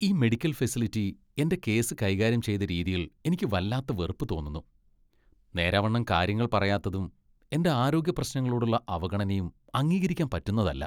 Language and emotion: Malayalam, disgusted